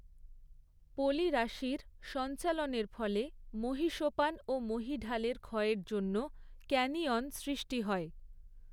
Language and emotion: Bengali, neutral